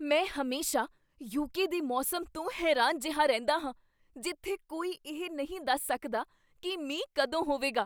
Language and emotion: Punjabi, surprised